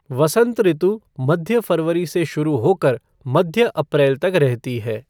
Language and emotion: Hindi, neutral